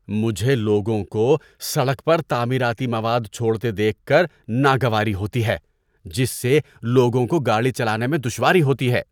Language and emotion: Urdu, disgusted